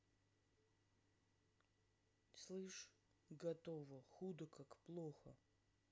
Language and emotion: Russian, neutral